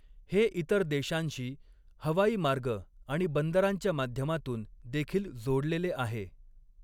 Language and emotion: Marathi, neutral